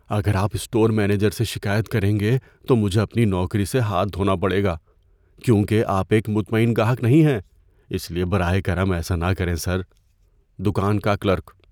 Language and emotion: Urdu, fearful